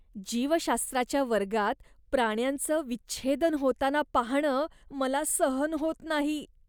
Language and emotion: Marathi, disgusted